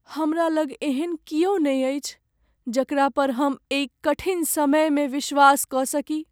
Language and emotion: Maithili, sad